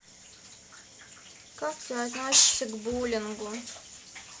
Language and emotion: Russian, sad